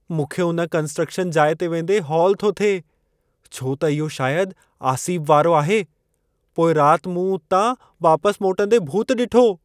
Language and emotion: Sindhi, fearful